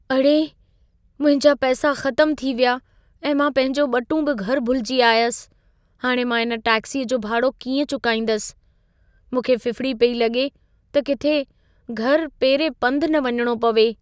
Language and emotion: Sindhi, fearful